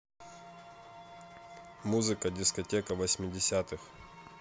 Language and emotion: Russian, neutral